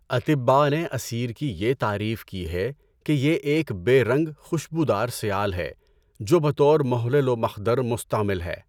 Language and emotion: Urdu, neutral